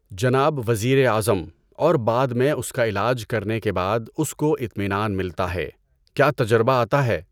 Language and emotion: Urdu, neutral